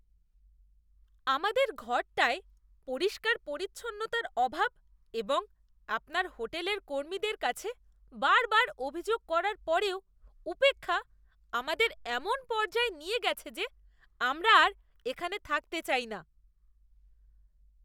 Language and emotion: Bengali, disgusted